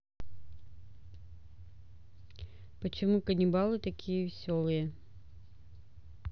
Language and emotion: Russian, neutral